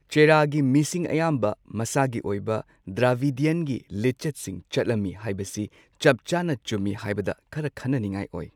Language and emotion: Manipuri, neutral